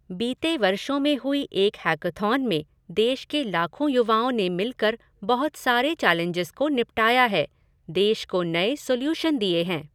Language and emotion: Hindi, neutral